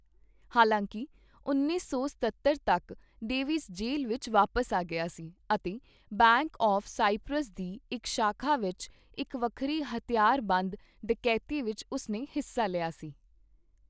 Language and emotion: Punjabi, neutral